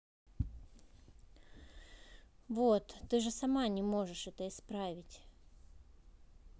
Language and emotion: Russian, neutral